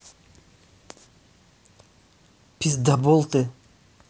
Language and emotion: Russian, angry